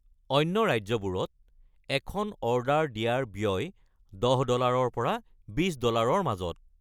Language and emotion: Assamese, neutral